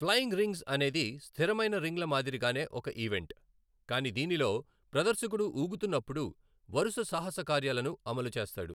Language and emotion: Telugu, neutral